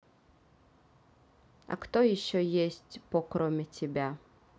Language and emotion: Russian, neutral